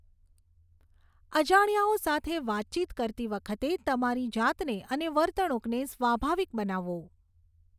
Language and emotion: Gujarati, neutral